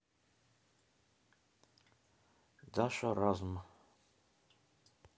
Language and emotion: Russian, neutral